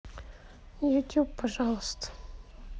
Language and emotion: Russian, sad